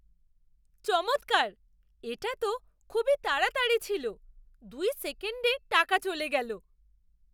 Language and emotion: Bengali, surprised